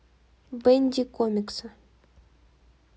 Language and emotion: Russian, neutral